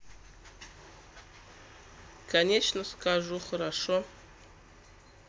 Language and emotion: Russian, neutral